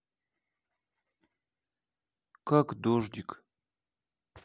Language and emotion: Russian, sad